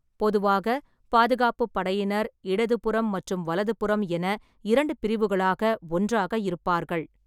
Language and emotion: Tamil, neutral